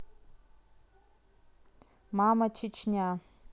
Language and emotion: Russian, neutral